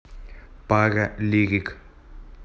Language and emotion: Russian, neutral